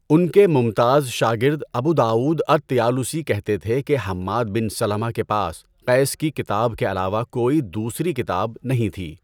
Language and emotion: Urdu, neutral